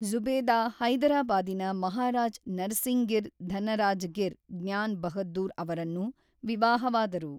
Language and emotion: Kannada, neutral